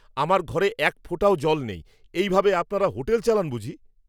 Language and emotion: Bengali, angry